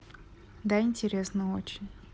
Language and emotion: Russian, neutral